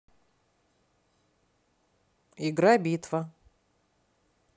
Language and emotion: Russian, neutral